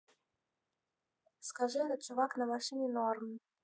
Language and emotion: Russian, neutral